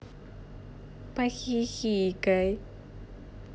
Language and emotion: Russian, positive